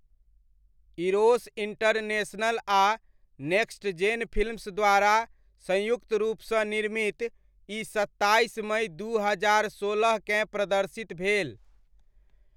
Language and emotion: Maithili, neutral